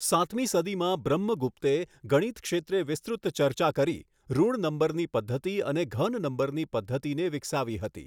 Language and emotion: Gujarati, neutral